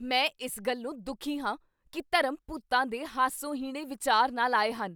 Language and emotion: Punjabi, angry